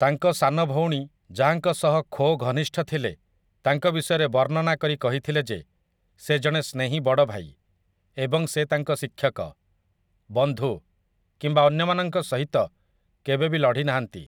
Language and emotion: Odia, neutral